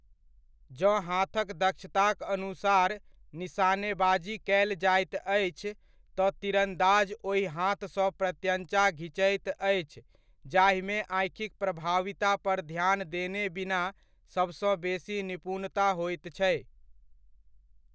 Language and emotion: Maithili, neutral